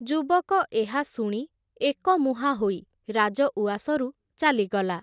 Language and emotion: Odia, neutral